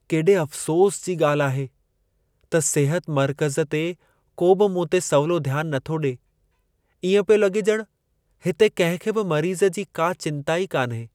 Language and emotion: Sindhi, sad